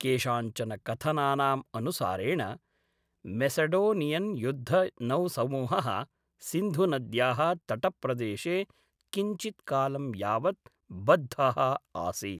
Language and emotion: Sanskrit, neutral